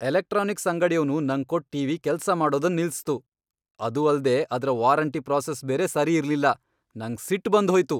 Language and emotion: Kannada, angry